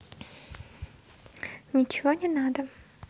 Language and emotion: Russian, neutral